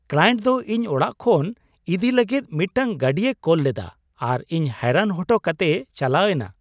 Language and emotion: Santali, surprised